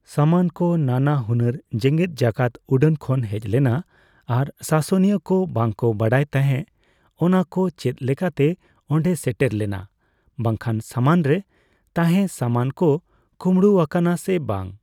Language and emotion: Santali, neutral